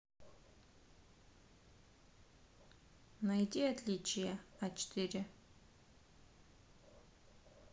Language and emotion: Russian, neutral